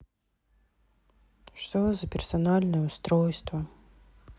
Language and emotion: Russian, sad